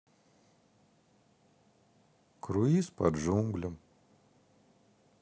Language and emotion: Russian, sad